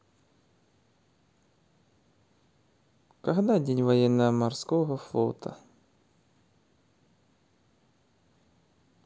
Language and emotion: Russian, neutral